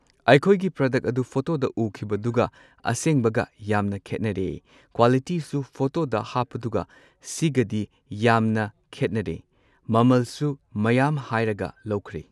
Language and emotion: Manipuri, neutral